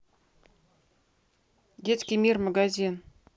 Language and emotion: Russian, neutral